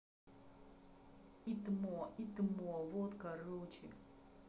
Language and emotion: Russian, angry